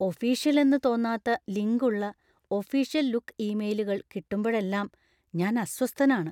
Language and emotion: Malayalam, fearful